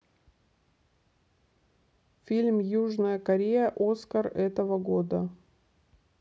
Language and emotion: Russian, neutral